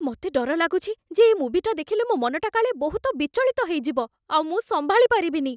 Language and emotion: Odia, fearful